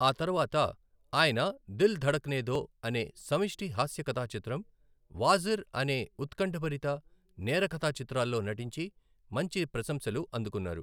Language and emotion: Telugu, neutral